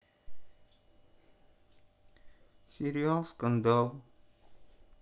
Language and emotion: Russian, sad